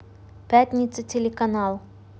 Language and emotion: Russian, neutral